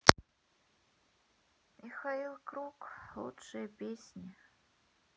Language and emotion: Russian, sad